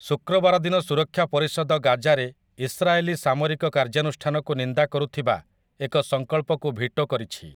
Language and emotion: Odia, neutral